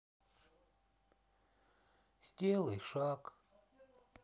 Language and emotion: Russian, sad